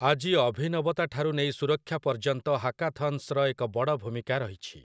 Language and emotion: Odia, neutral